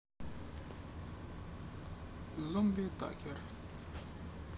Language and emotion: Russian, neutral